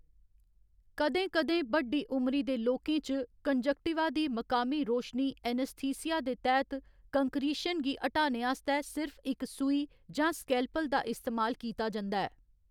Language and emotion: Dogri, neutral